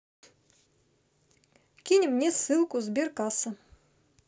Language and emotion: Russian, neutral